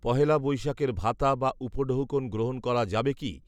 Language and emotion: Bengali, neutral